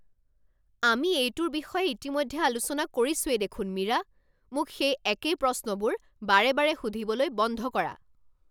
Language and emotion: Assamese, angry